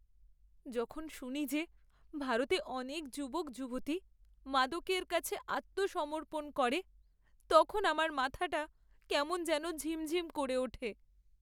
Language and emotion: Bengali, sad